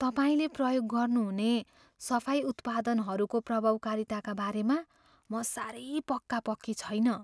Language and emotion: Nepali, fearful